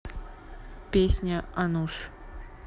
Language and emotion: Russian, neutral